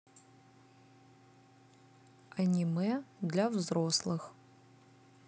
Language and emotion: Russian, neutral